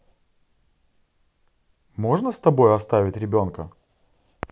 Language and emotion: Russian, positive